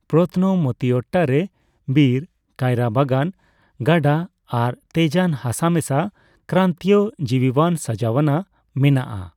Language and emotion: Santali, neutral